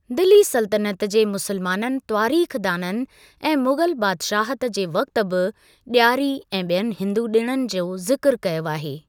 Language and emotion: Sindhi, neutral